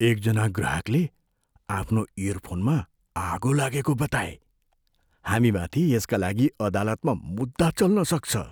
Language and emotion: Nepali, fearful